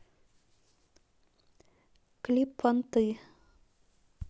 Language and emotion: Russian, neutral